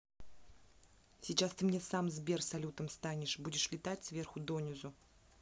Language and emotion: Russian, angry